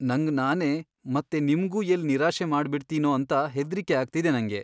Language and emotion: Kannada, fearful